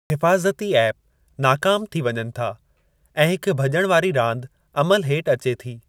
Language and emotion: Sindhi, neutral